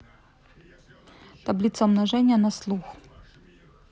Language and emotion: Russian, neutral